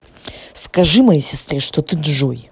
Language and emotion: Russian, angry